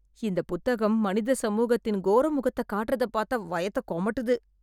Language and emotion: Tamil, disgusted